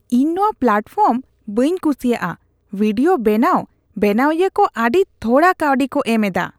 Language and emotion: Santali, disgusted